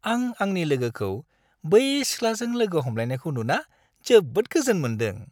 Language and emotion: Bodo, happy